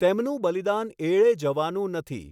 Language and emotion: Gujarati, neutral